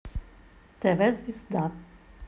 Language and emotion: Russian, neutral